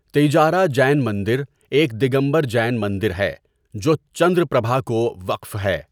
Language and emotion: Urdu, neutral